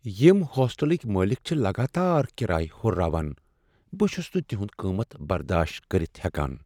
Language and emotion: Kashmiri, sad